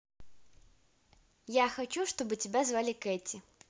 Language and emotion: Russian, positive